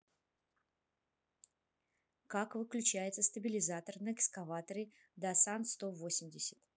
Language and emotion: Russian, neutral